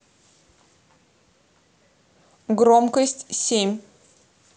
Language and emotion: Russian, neutral